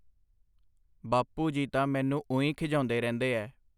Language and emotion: Punjabi, neutral